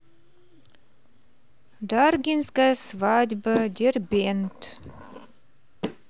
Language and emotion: Russian, neutral